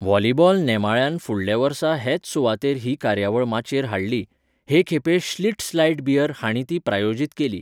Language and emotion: Goan Konkani, neutral